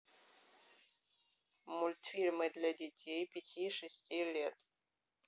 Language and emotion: Russian, neutral